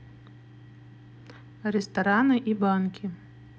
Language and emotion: Russian, neutral